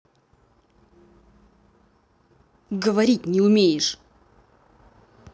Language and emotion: Russian, angry